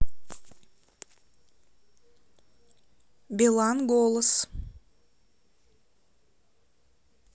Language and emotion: Russian, neutral